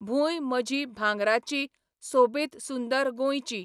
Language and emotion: Goan Konkani, neutral